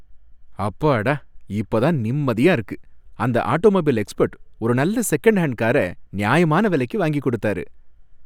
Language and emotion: Tamil, happy